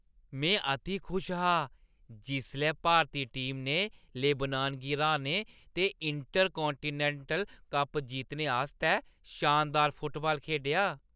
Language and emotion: Dogri, happy